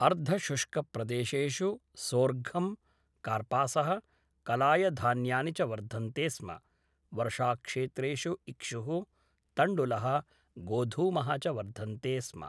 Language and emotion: Sanskrit, neutral